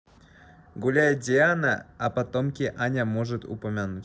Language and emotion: Russian, neutral